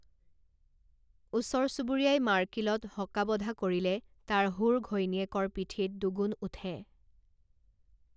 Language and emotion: Assamese, neutral